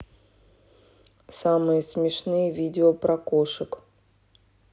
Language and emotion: Russian, neutral